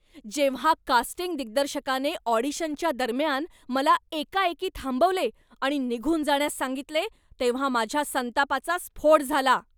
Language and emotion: Marathi, angry